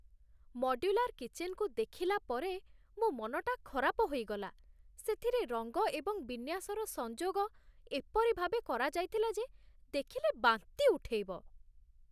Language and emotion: Odia, disgusted